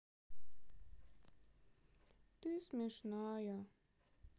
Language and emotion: Russian, sad